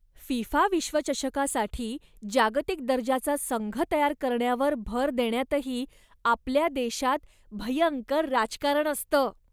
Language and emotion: Marathi, disgusted